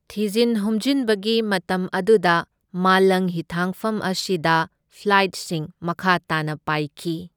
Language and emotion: Manipuri, neutral